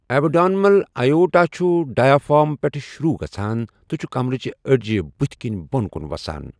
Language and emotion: Kashmiri, neutral